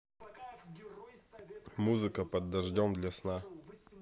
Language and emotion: Russian, neutral